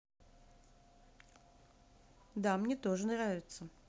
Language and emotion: Russian, neutral